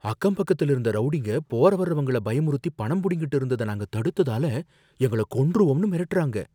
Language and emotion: Tamil, fearful